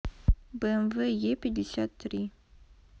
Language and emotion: Russian, neutral